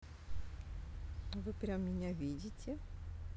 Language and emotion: Russian, positive